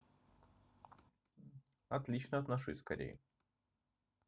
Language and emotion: Russian, neutral